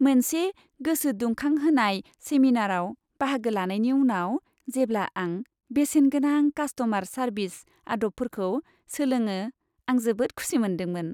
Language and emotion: Bodo, happy